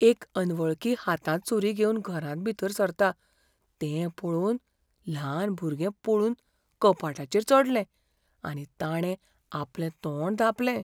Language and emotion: Goan Konkani, fearful